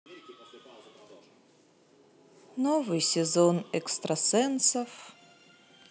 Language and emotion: Russian, sad